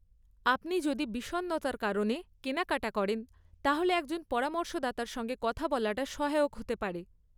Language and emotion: Bengali, neutral